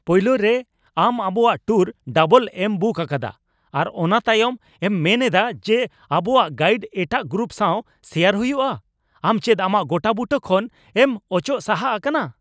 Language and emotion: Santali, angry